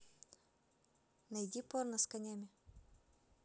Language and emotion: Russian, neutral